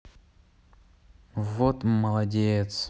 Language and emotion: Russian, neutral